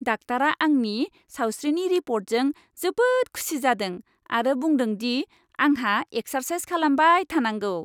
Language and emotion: Bodo, happy